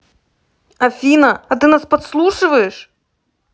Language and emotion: Russian, neutral